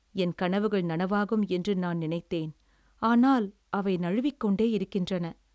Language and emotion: Tamil, sad